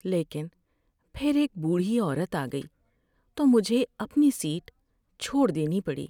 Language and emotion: Urdu, sad